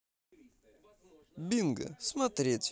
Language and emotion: Russian, positive